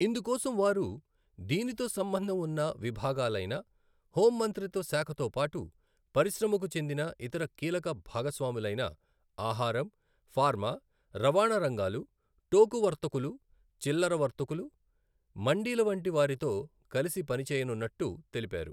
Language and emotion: Telugu, neutral